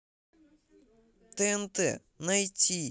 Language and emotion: Russian, neutral